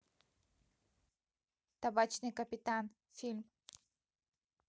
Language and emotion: Russian, neutral